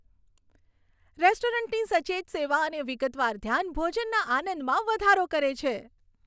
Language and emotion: Gujarati, happy